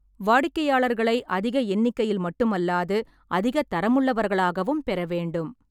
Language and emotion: Tamil, neutral